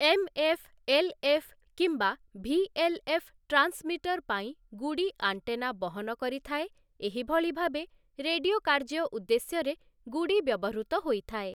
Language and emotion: Odia, neutral